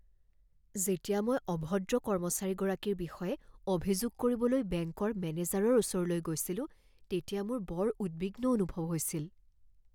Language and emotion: Assamese, fearful